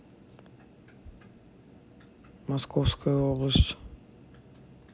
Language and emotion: Russian, neutral